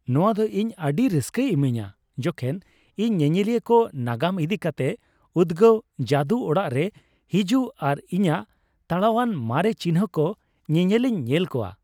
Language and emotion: Santali, happy